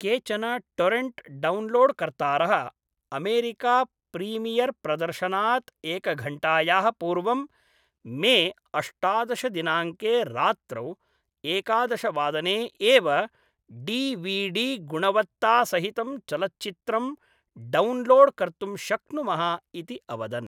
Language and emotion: Sanskrit, neutral